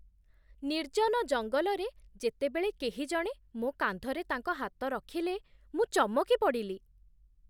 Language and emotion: Odia, surprised